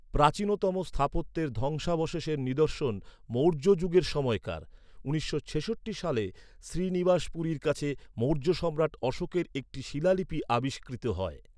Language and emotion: Bengali, neutral